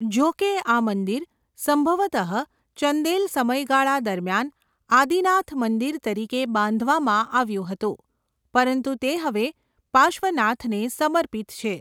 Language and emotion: Gujarati, neutral